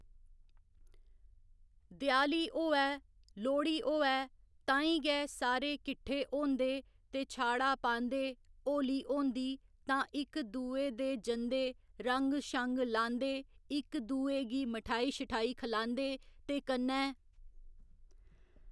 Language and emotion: Dogri, neutral